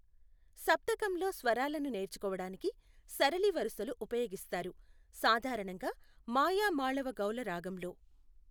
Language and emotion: Telugu, neutral